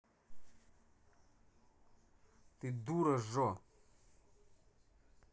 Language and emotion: Russian, angry